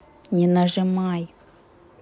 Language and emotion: Russian, angry